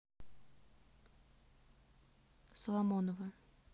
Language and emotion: Russian, neutral